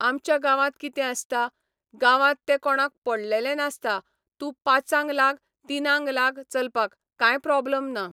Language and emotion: Goan Konkani, neutral